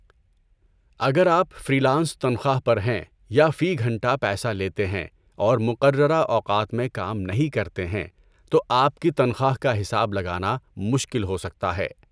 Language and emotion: Urdu, neutral